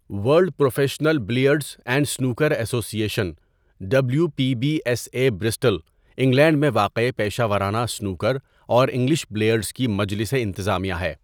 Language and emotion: Urdu, neutral